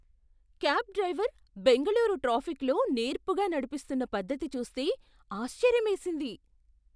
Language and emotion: Telugu, surprised